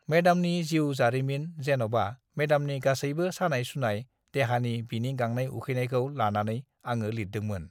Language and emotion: Bodo, neutral